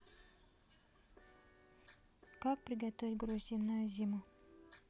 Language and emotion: Russian, neutral